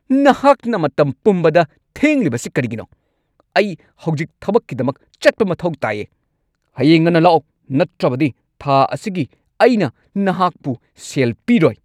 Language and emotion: Manipuri, angry